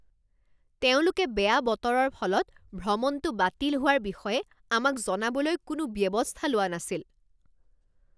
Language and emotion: Assamese, angry